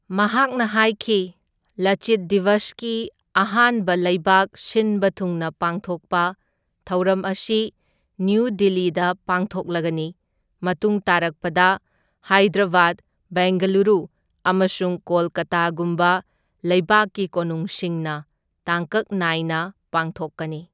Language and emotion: Manipuri, neutral